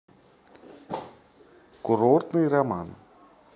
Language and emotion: Russian, neutral